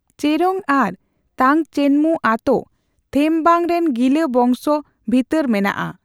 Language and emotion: Santali, neutral